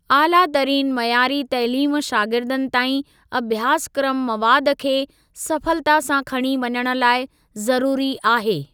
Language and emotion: Sindhi, neutral